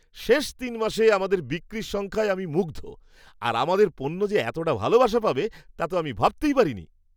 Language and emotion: Bengali, surprised